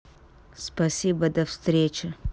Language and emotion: Russian, angry